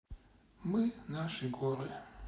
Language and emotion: Russian, sad